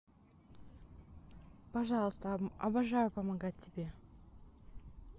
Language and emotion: Russian, neutral